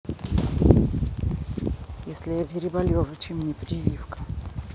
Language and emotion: Russian, neutral